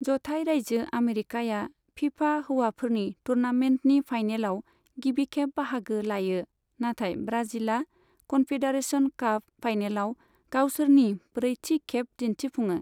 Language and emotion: Bodo, neutral